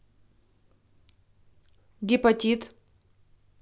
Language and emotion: Russian, neutral